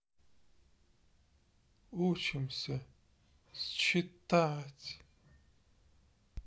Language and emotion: Russian, sad